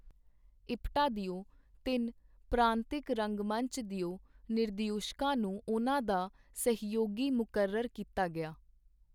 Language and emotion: Punjabi, neutral